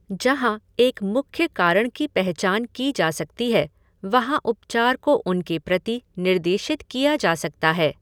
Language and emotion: Hindi, neutral